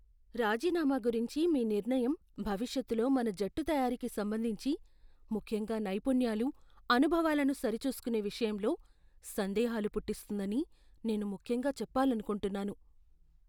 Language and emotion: Telugu, fearful